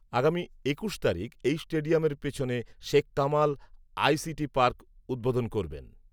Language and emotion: Bengali, neutral